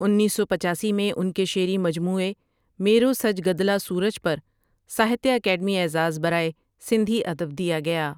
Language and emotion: Urdu, neutral